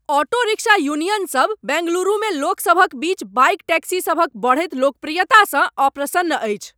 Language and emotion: Maithili, angry